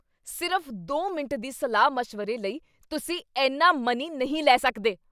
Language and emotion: Punjabi, angry